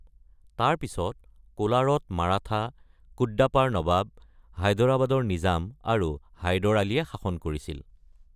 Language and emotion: Assamese, neutral